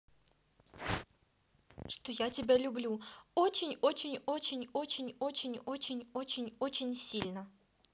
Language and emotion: Russian, positive